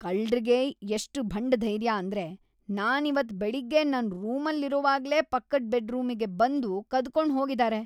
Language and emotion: Kannada, disgusted